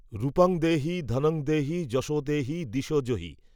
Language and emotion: Bengali, neutral